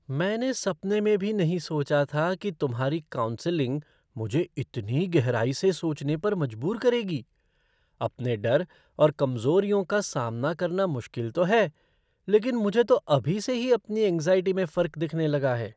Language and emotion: Hindi, surprised